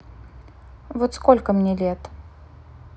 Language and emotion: Russian, neutral